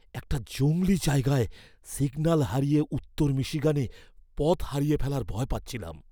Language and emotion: Bengali, fearful